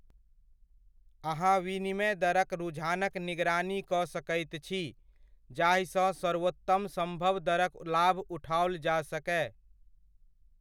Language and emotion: Maithili, neutral